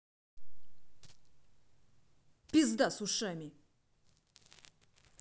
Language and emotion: Russian, angry